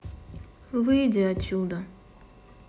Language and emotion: Russian, sad